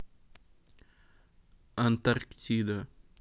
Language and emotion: Russian, neutral